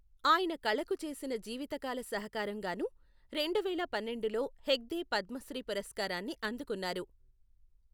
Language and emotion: Telugu, neutral